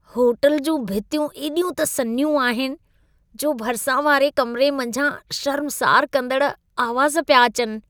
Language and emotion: Sindhi, disgusted